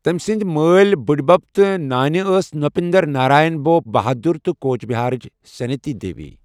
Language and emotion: Kashmiri, neutral